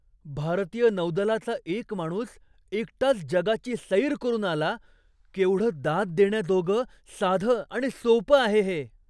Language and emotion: Marathi, surprised